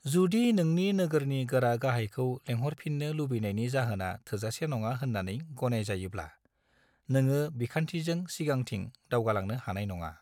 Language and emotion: Bodo, neutral